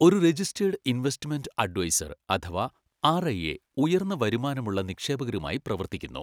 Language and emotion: Malayalam, neutral